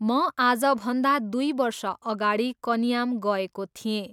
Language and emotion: Nepali, neutral